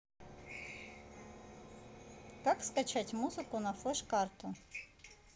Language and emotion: Russian, neutral